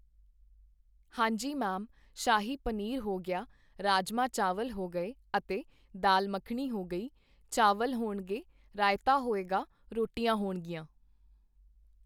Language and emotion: Punjabi, neutral